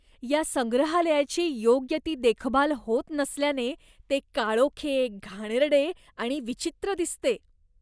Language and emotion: Marathi, disgusted